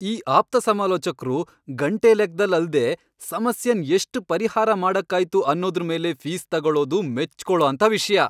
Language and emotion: Kannada, happy